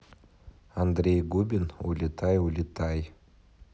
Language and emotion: Russian, neutral